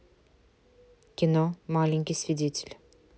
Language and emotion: Russian, neutral